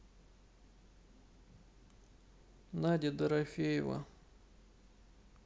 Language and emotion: Russian, sad